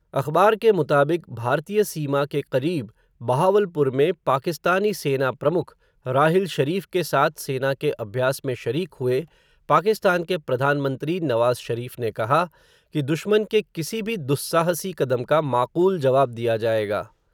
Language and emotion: Hindi, neutral